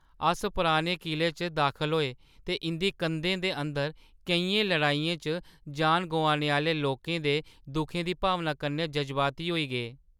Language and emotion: Dogri, sad